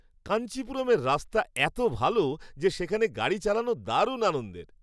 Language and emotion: Bengali, happy